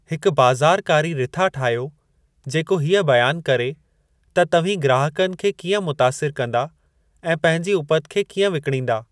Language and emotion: Sindhi, neutral